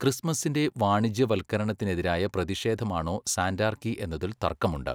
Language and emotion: Malayalam, neutral